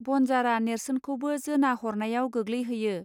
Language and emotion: Bodo, neutral